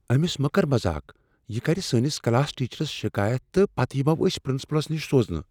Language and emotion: Kashmiri, fearful